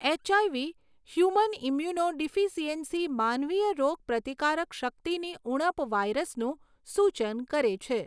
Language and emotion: Gujarati, neutral